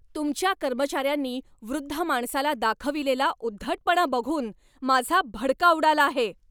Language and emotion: Marathi, angry